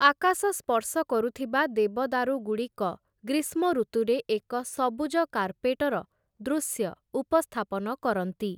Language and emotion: Odia, neutral